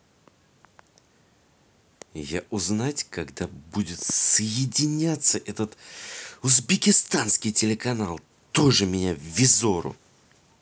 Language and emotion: Russian, angry